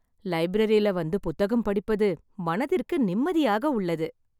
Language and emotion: Tamil, happy